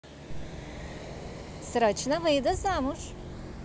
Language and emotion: Russian, positive